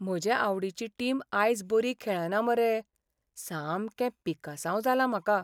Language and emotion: Goan Konkani, sad